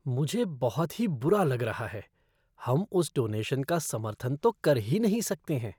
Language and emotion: Hindi, disgusted